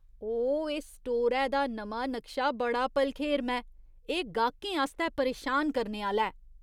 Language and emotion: Dogri, disgusted